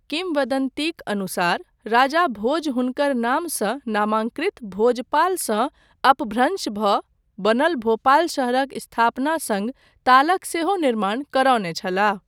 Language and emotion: Maithili, neutral